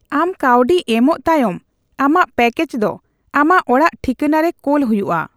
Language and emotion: Santali, neutral